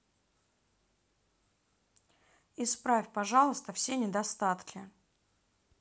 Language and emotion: Russian, neutral